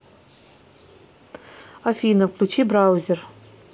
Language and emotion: Russian, neutral